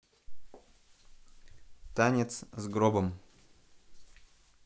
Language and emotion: Russian, neutral